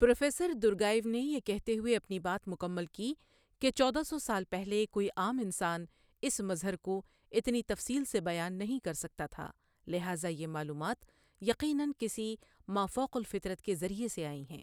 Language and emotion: Urdu, neutral